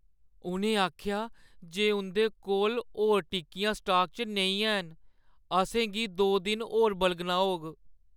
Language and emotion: Dogri, sad